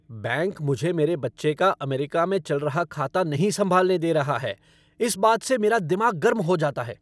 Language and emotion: Hindi, angry